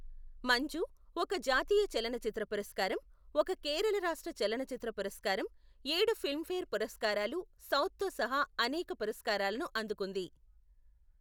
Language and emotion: Telugu, neutral